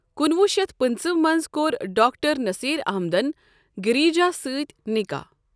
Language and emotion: Kashmiri, neutral